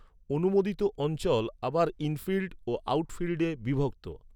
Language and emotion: Bengali, neutral